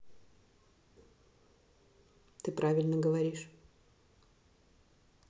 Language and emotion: Russian, neutral